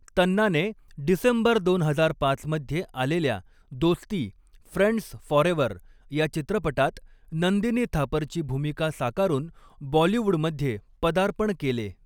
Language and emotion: Marathi, neutral